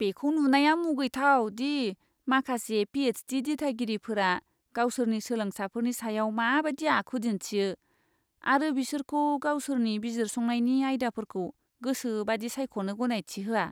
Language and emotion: Bodo, disgusted